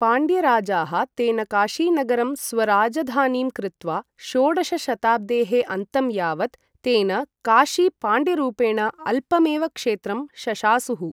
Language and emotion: Sanskrit, neutral